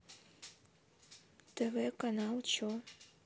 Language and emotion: Russian, neutral